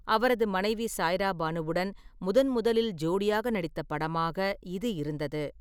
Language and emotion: Tamil, neutral